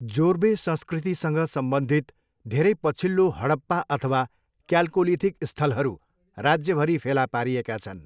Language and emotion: Nepali, neutral